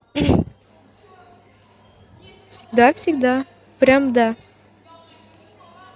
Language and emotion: Russian, neutral